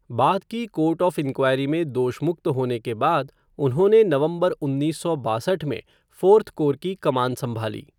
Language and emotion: Hindi, neutral